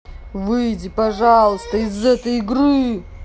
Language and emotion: Russian, angry